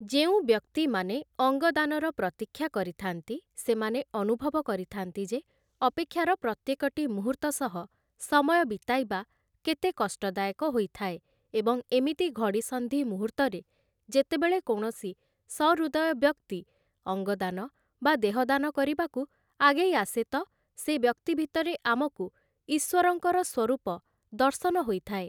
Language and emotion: Odia, neutral